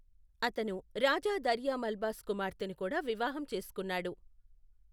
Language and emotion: Telugu, neutral